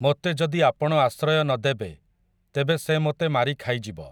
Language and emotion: Odia, neutral